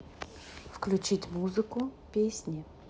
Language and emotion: Russian, neutral